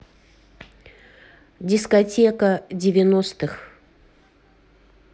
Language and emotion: Russian, neutral